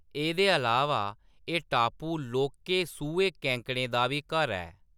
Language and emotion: Dogri, neutral